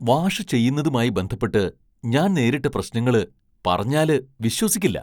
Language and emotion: Malayalam, surprised